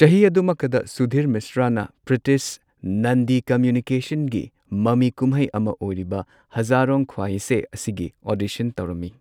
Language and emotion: Manipuri, neutral